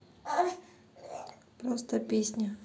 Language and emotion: Russian, neutral